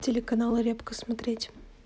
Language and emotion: Russian, neutral